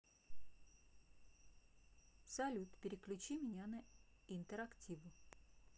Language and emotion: Russian, neutral